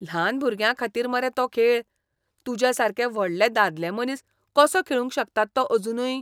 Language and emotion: Goan Konkani, disgusted